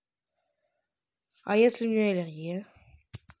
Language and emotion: Russian, neutral